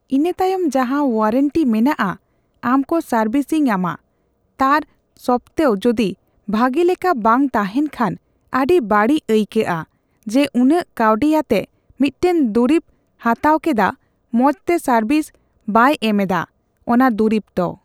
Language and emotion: Santali, neutral